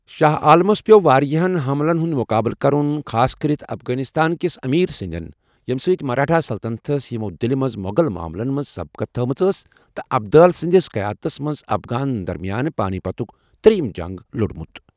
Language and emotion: Kashmiri, neutral